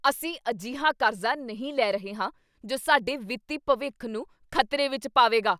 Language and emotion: Punjabi, angry